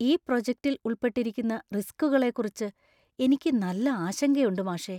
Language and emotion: Malayalam, fearful